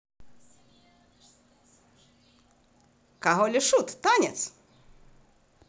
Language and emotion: Russian, positive